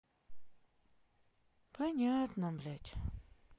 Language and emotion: Russian, sad